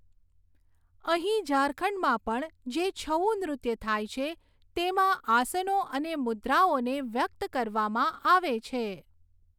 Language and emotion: Gujarati, neutral